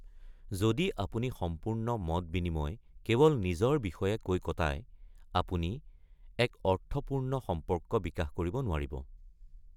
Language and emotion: Assamese, neutral